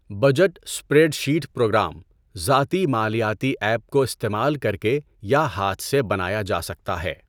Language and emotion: Urdu, neutral